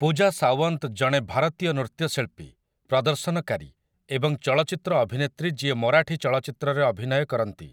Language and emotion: Odia, neutral